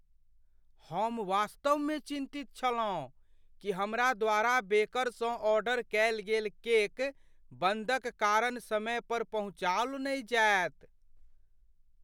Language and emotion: Maithili, fearful